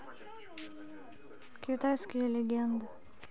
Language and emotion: Russian, neutral